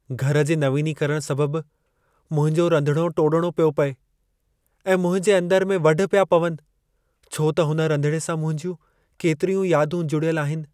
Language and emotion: Sindhi, sad